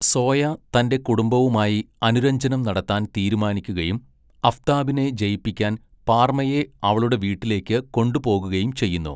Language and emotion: Malayalam, neutral